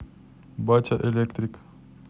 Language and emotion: Russian, neutral